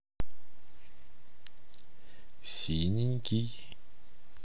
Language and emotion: Russian, neutral